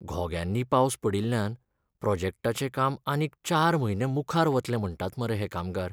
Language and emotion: Goan Konkani, sad